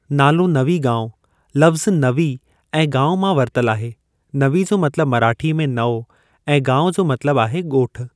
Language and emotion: Sindhi, neutral